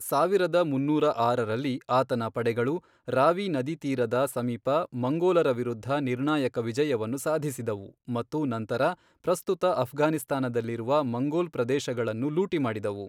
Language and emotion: Kannada, neutral